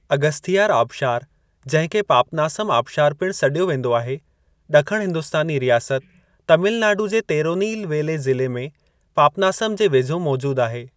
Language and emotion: Sindhi, neutral